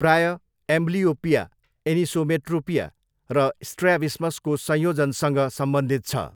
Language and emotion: Nepali, neutral